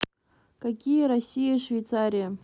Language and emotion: Russian, neutral